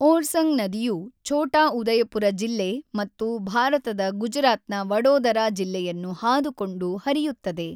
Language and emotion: Kannada, neutral